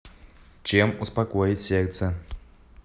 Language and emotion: Russian, neutral